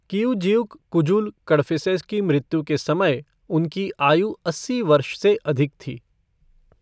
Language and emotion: Hindi, neutral